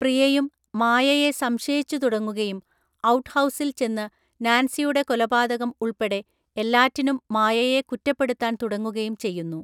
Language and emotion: Malayalam, neutral